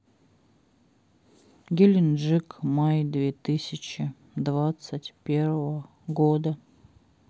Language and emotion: Russian, sad